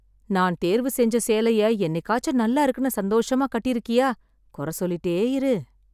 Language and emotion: Tamil, sad